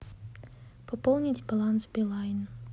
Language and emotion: Russian, neutral